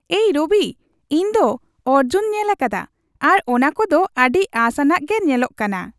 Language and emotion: Santali, happy